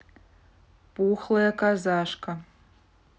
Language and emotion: Russian, neutral